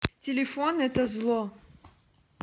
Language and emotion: Russian, neutral